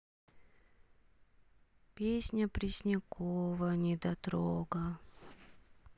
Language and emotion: Russian, sad